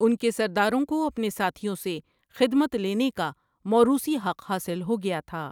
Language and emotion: Urdu, neutral